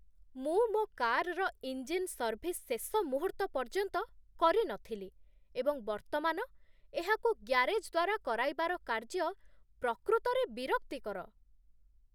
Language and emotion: Odia, disgusted